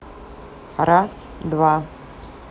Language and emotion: Russian, neutral